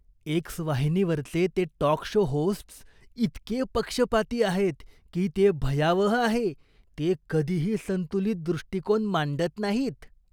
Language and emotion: Marathi, disgusted